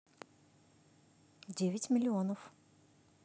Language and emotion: Russian, neutral